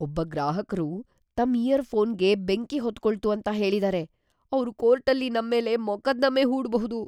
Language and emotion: Kannada, fearful